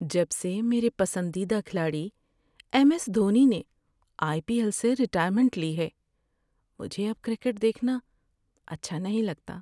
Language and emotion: Urdu, sad